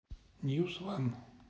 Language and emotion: Russian, neutral